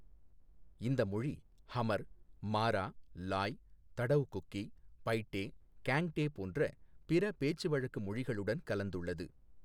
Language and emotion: Tamil, neutral